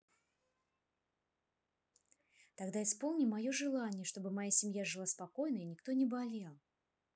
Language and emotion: Russian, neutral